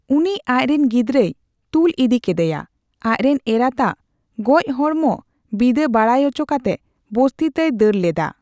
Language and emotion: Santali, neutral